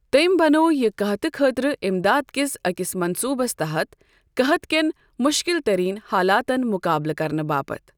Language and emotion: Kashmiri, neutral